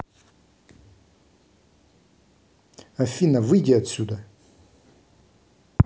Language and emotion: Russian, angry